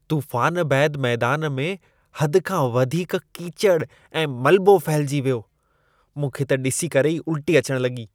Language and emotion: Sindhi, disgusted